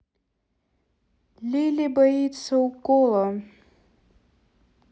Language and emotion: Russian, neutral